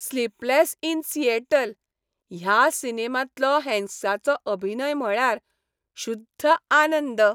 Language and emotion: Goan Konkani, happy